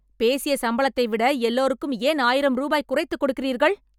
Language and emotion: Tamil, angry